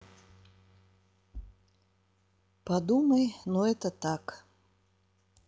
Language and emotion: Russian, sad